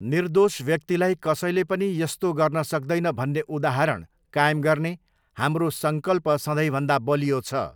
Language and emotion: Nepali, neutral